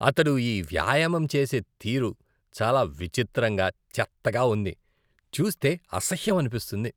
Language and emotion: Telugu, disgusted